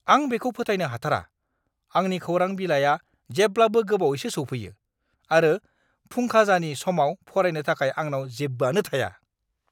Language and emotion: Bodo, angry